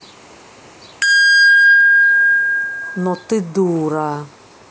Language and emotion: Russian, angry